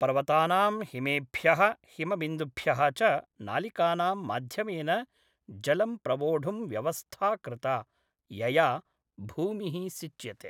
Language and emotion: Sanskrit, neutral